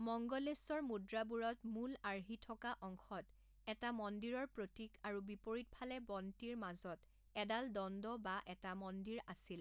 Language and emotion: Assamese, neutral